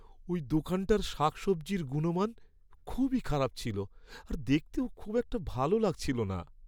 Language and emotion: Bengali, sad